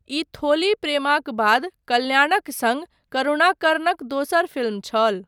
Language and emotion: Maithili, neutral